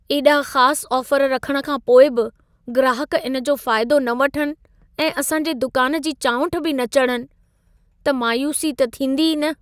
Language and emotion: Sindhi, sad